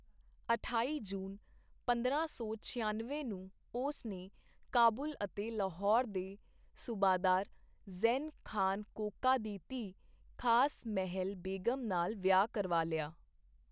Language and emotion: Punjabi, neutral